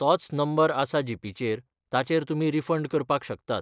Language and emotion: Goan Konkani, neutral